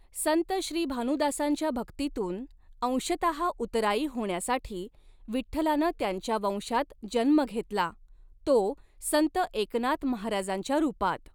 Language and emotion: Marathi, neutral